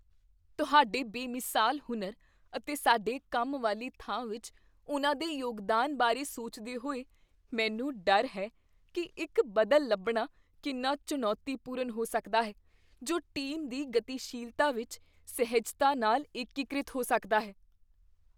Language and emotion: Punjabi, fearful